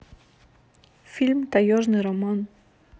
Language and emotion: Russian, neutral